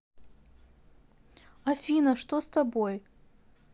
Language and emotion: Russian, sad